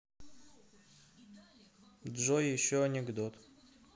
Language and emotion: Russian, neutral